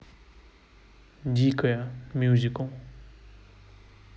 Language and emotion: Russian, neutral